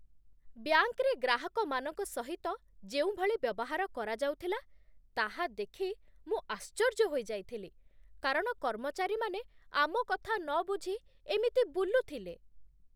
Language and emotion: Odia, disgusted